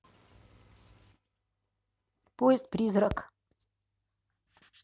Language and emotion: Russian, neutral